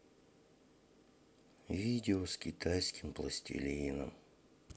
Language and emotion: Russian, sad